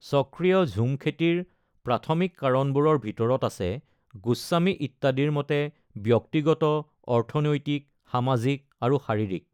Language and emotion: Assamese, neutral